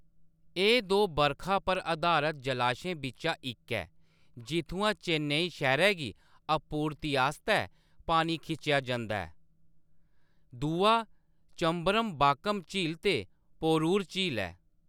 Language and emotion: Dogri, neutral